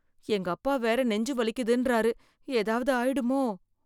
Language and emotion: Tamil, fearful